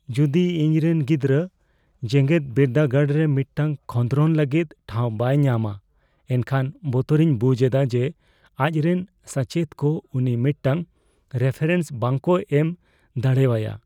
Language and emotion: Santali, fearful